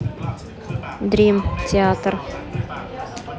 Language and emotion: Russian, neutral